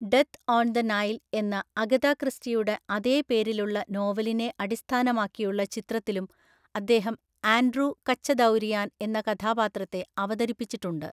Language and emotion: Malayalam, neutral